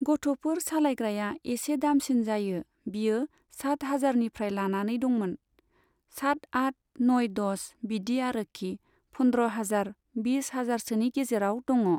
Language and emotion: Bodo, neutral